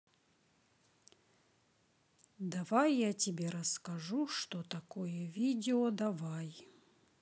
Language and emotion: Russian, neutral